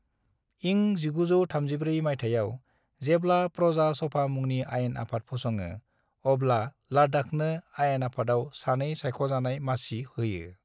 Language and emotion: Bodo, neutral